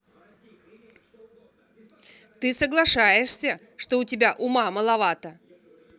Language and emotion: Russian, angry